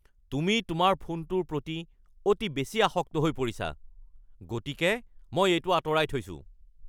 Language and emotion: Assamese, angry